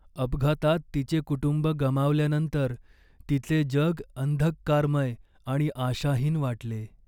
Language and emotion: Marathi, sad